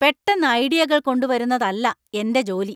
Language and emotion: Malayalam, angry